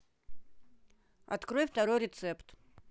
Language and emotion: Russian, neutral